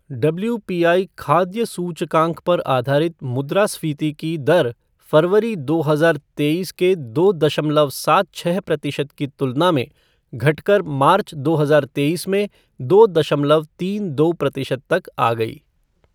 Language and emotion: Hindi, neutral